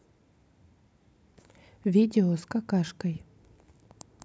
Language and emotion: Russian, neutral